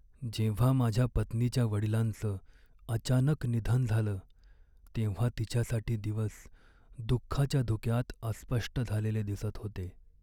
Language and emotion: Marathi, sad